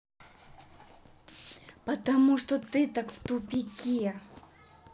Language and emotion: Russian, angry